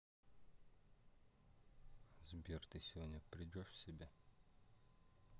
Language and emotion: Russian, neutral